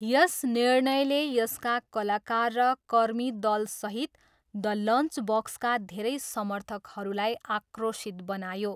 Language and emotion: Nepali, neutral